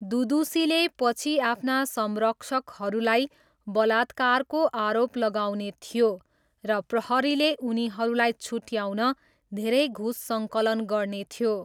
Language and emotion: Nepali, neutral